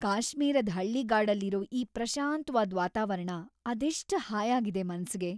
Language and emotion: Kannada, happy